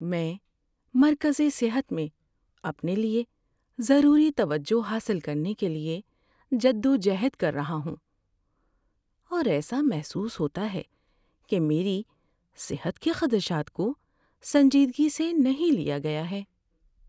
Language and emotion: Urdu, sad